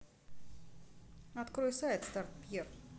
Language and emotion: Russian, neutral